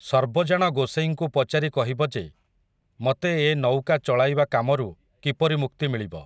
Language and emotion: Odia, neutral